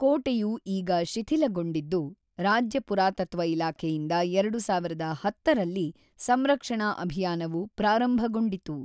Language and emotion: Kannada, neutral